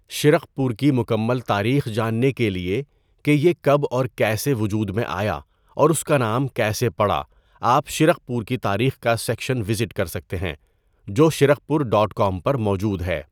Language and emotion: Urdu, neutral